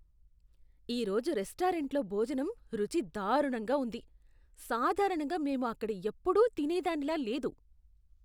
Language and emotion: Telugu, disgusted